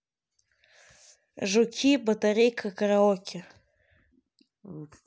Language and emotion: Russian, neutral